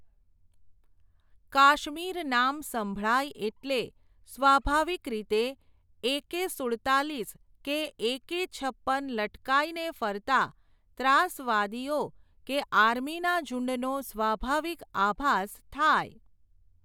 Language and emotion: Gujarati, neutral